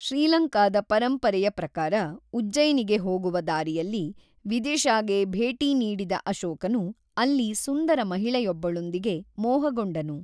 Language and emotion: Kannada, neutral